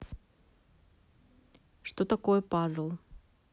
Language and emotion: Russian, neutral